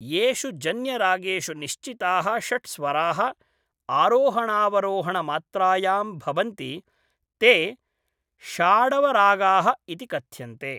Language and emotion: Sanskrit, neutral